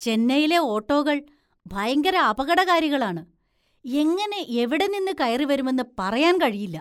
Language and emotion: Malayalam, disgusted